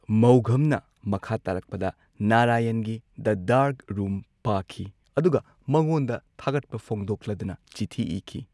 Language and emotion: Manipuri, neutral